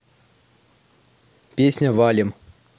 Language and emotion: Russian, neutral